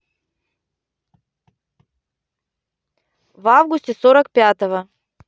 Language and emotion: Russian, neutral